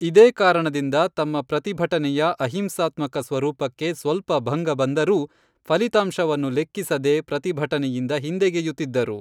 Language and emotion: Kannada, neutral